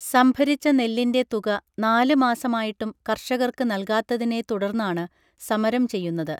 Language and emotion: Malayalam, neutral